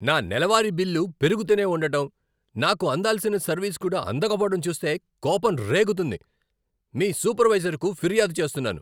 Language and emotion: Telugu, angry